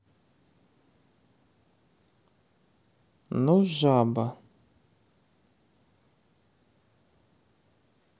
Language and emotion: Russian, neutral